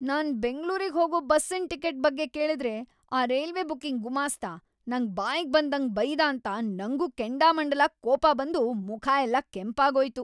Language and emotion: Kannada, angry